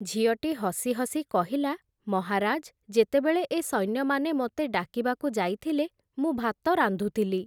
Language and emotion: Odia, neutral